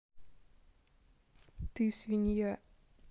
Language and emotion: Russian, neutral